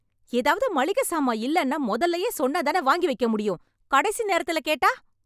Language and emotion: Tamil, angry